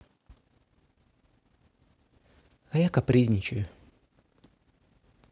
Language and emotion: Russian, sad